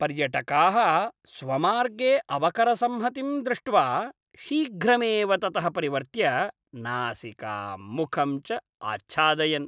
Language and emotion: Sanskrit, disgusted